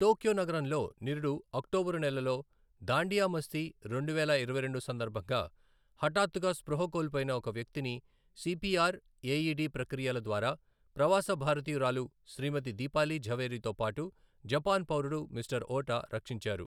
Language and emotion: Telugu, neutral